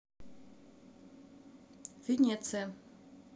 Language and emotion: Russian, neutral